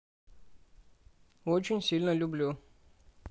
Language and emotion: Russian, neutral